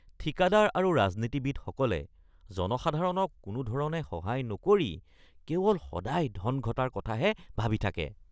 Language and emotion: Assamese, disgusted